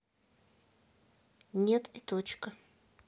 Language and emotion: Russian, neutral